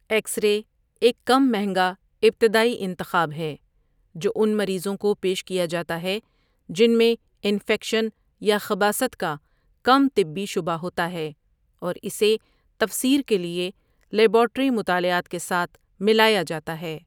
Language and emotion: Urdu, neutral